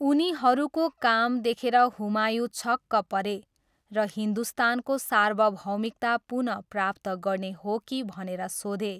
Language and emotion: Nepali, neutral